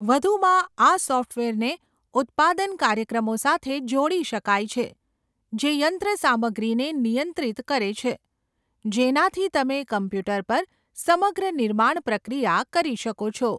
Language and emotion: Gujarati, neutral